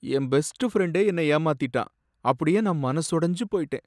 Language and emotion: Tamil, sad